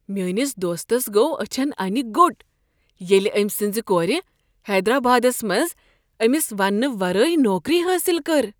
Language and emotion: Kashmiri, surprised